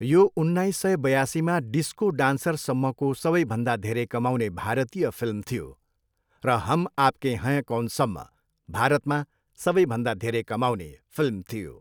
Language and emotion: Nepali, neutral